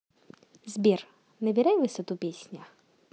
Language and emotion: Russian, positive